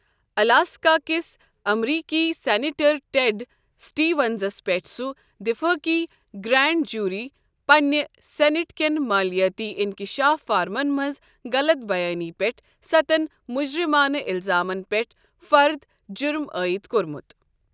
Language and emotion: Kashmiri, neutral